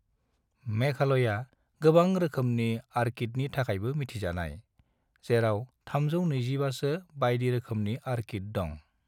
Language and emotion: Bodo, neutral